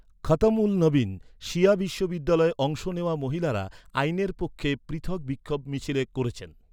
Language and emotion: Bengali, neutral